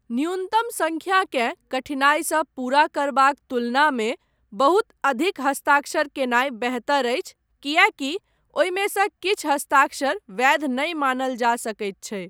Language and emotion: Maithili, neutral